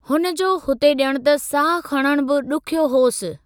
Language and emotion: Sindhi, neutral